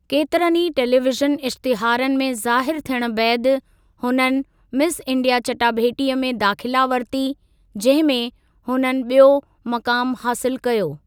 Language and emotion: Sindhi, neutral